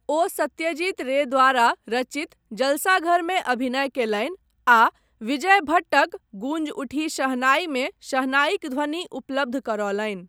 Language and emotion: Maithili, neutral